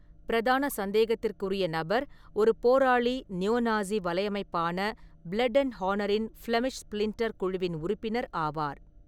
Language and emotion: Tamil, neutral